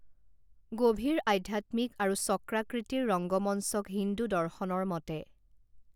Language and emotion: Assamese, neutral